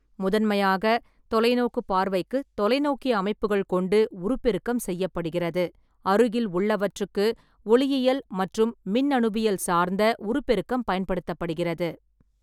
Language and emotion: Tamil, neutral